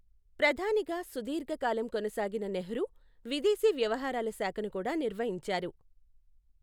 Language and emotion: Telugu, neutral